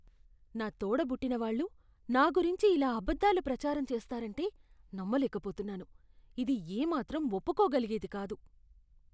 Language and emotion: Telugu, disgusted